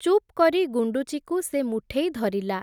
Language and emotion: Odia, neutral